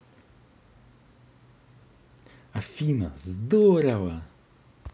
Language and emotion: Russian, positive